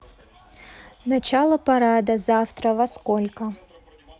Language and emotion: Russian, neutral